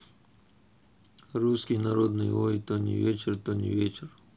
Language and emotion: Russian, neutral